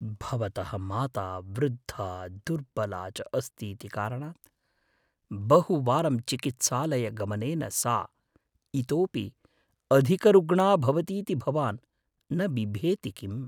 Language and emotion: Sanskrit, fearful